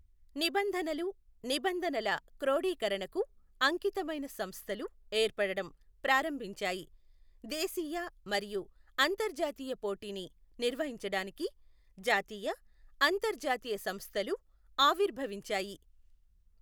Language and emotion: Telugu, neutral